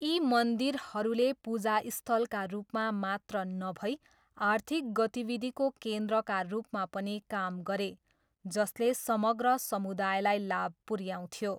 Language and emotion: Nepali, neutral